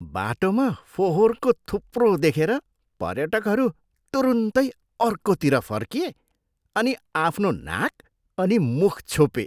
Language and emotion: Nepali, disgusted